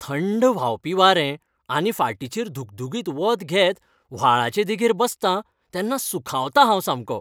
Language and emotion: Goan Konkani, happy